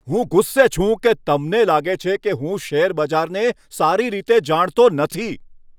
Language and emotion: Gujarati, angry